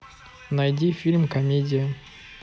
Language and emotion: Russian, neutral